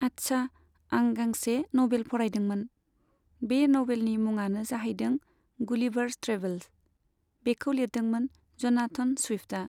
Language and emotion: Bodo, neutral